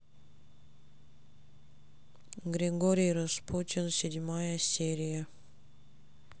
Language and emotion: Russian, sad